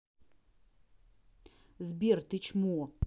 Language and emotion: Russian, angry